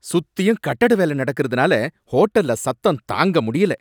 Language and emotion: Tamil, angry